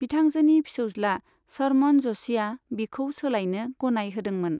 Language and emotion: Bodo, neutral